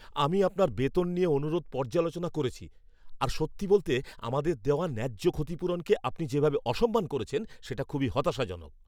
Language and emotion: Bengali, angry